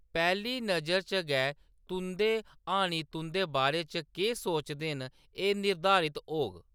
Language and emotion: Dogri, neutral